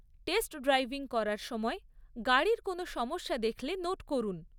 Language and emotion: Bengali, neutral